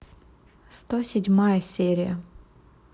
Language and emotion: Russian, neutral